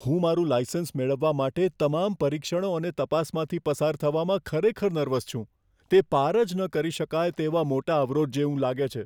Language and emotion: Gujarati, fearful